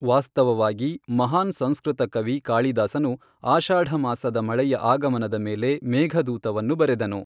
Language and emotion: Kannada, neutral